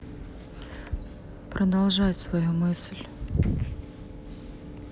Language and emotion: Russian, neutral